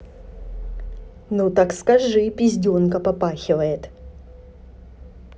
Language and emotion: Russian, neutral